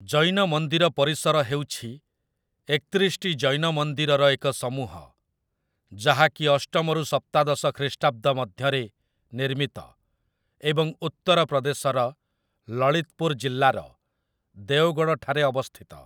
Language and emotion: Odia, neutral